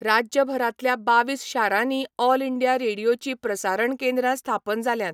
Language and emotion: Goan Konkani, neutral